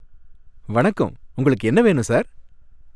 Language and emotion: Tamil, happy